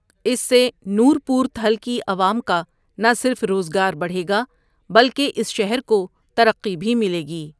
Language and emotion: Urdu, neutral